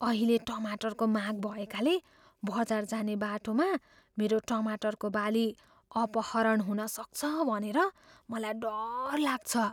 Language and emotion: Nepali, fearful